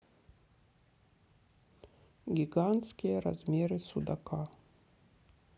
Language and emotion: Russian, neutral